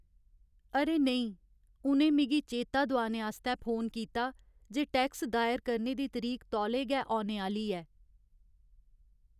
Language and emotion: Dogri, sad